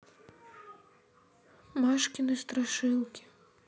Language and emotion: Russian, sad